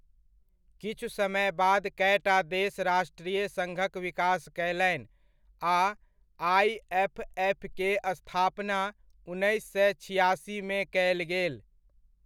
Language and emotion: Maithili, neutral